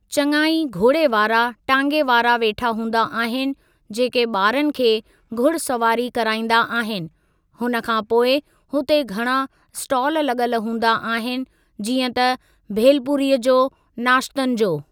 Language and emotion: Sindhi, neutral